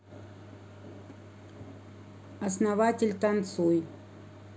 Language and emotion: Russian, neutral